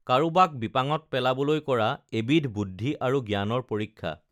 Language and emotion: Assamese, neutral